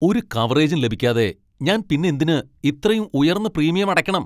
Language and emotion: Malayalam, angry